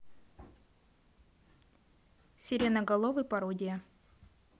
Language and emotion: Russian, neutral